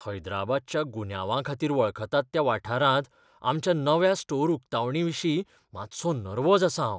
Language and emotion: Goan Konkani, fearful